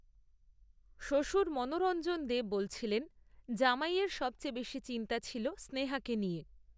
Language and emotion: Bengali, neutral